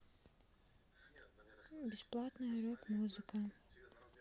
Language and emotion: Russian, neutral